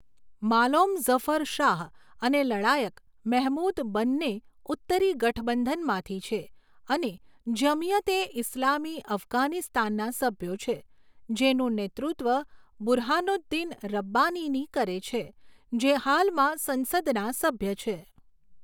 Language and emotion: Gujarati, neutral